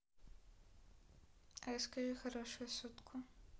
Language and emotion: Russian, neutral